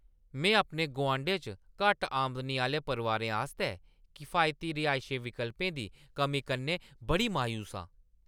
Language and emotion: Dogri, angry